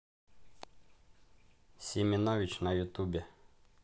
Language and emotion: Russian, neutral